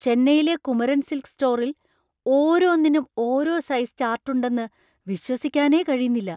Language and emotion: Malayalam, surprised